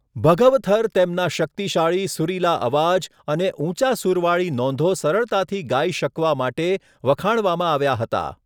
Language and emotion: Gujarati, neutral